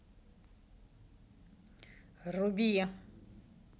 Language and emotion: Russian, neutral